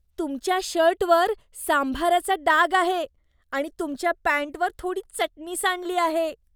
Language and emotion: Marathi, disgusted